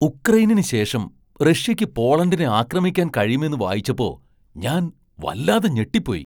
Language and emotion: Malayalam, surprised